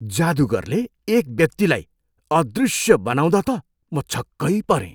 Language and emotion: Nepali, surprised